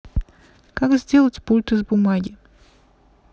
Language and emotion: Russian, neutral